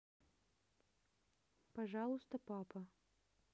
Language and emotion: Russian, neutral